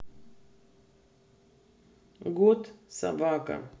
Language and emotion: Russian, neutral